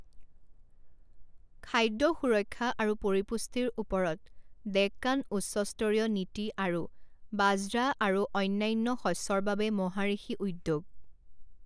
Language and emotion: Assamese, neutral